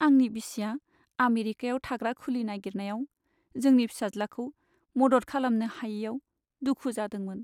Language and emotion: Bodo, sad